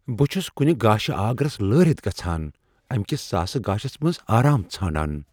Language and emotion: Kashmiri, fearful